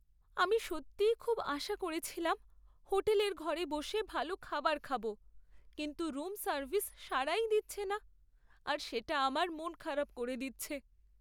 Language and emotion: Bengali, sad